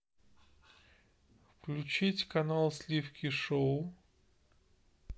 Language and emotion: Russian, neutral